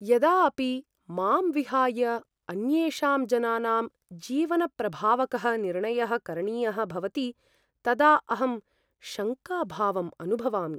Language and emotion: Sanskrit, fearful